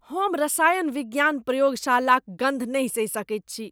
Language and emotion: Maithili, disgusted